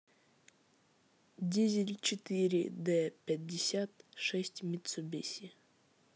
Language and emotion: Russian, neutral